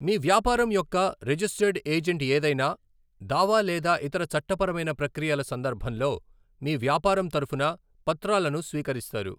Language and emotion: Telugu, neutral